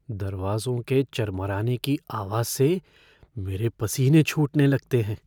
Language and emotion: Hindi, fearful